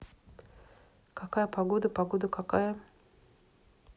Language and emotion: Russian, neutral